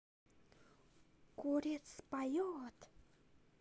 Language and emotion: Russian, positive